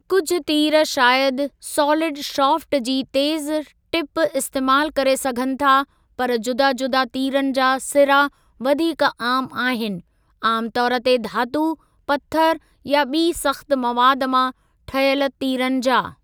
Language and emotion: Sindhi, neutral